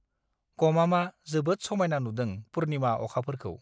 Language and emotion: Bodo, neutral